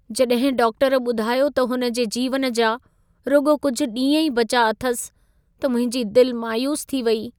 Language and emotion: Sindhi, sad